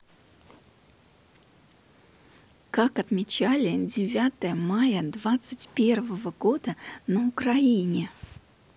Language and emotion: Russian, neutral